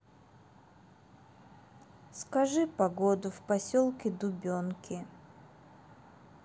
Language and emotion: Russian, sad